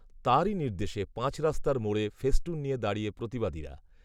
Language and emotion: Bengali, neutral